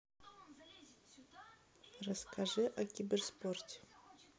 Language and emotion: Russian, neutral